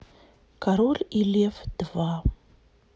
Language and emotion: Russian, sad